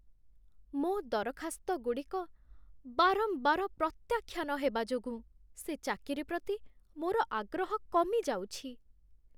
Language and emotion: Odia, sad